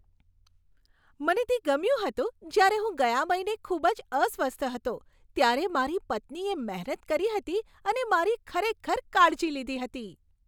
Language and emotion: Gujarati, happy